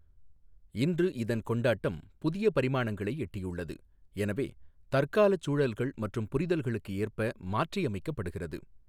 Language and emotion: Tamil, neutral